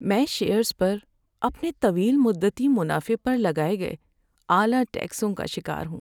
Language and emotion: Urdu, sad